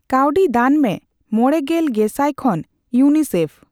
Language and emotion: Santali, neutral